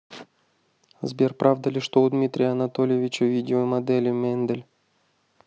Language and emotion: Russian, neutral